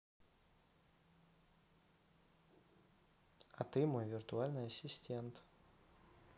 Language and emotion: Russian, neutral